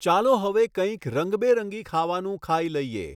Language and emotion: Gujarati, neutral